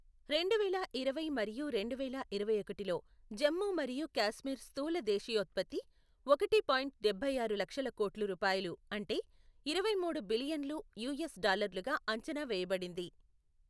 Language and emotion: Telugu, neutral